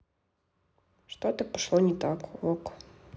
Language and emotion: Russian, neutral